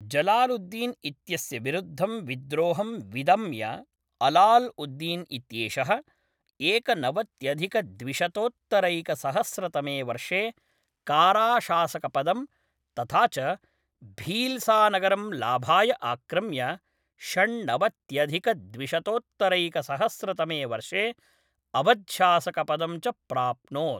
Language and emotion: Sanskrit, neutral